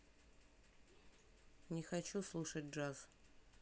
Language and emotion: Russian, neutral